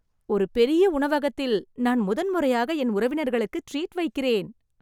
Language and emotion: Tamil, happy